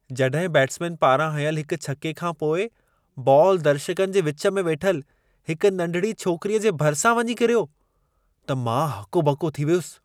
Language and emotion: Sindhi, surprised